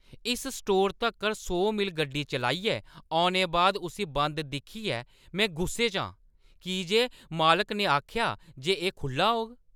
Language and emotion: Dogri, angry